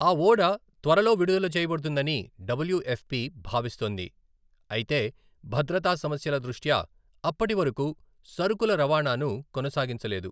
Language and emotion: Telugu, neutral